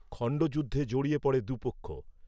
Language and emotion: Bengali, neutral